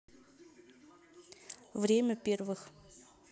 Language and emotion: Russian, neutral